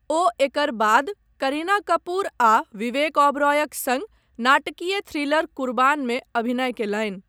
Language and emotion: Maithili, neutral